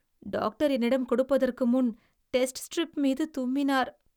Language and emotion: Tamil, disgusted